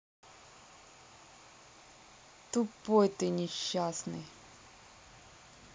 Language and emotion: Russian, neutral